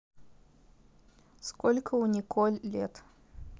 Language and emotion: Russian, neutral